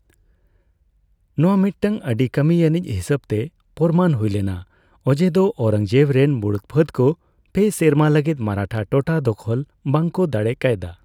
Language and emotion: Santali, neutral